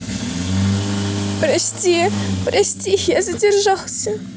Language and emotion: Russian, sad